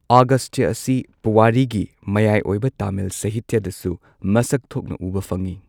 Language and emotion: Manipuri, neutral